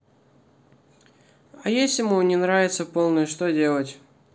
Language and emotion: Russian, neutral